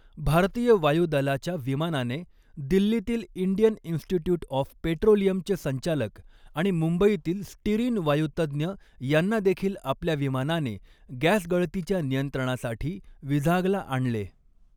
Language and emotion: Marathi, neutral